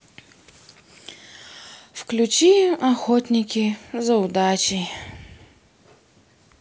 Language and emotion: Russian, sad